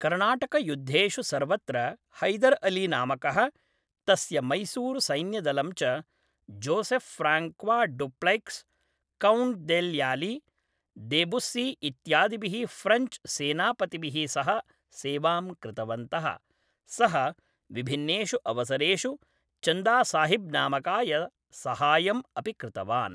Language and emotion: Sanskrit, neutral